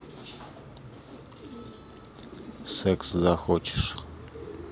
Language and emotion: Russian, neutral